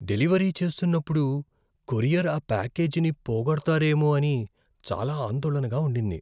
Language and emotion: Telugu, fearful